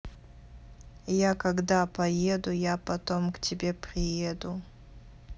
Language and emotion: Russian, neutral